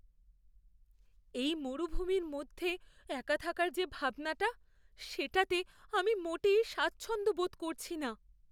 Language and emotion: Bengali, fearful